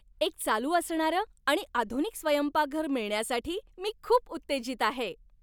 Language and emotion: Marathi, happy